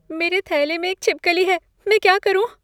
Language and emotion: Hindi, fearful